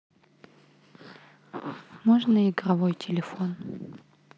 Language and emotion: Russian, neutral